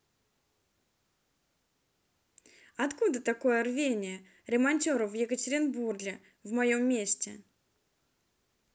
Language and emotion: Russian, positive